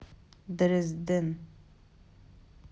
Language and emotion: Russian, neutral